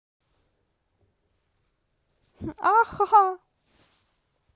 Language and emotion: Russian, positive